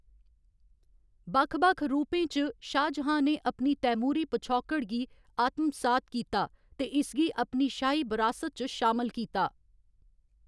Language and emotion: Dogri, neutral